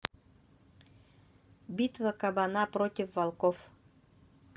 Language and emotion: Russian, neutral